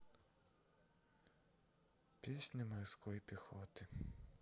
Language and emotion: Russian, sad